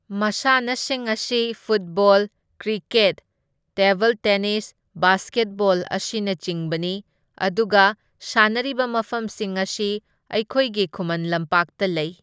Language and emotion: Manipuri, neutral